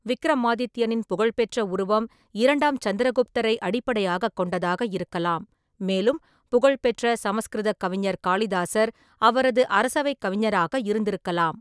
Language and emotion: Tamil, neutral